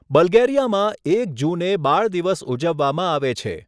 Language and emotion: Gujarati, neutral